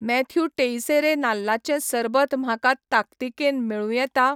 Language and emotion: Goan Konkani, neutral